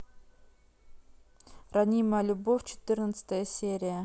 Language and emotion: Russian, neutral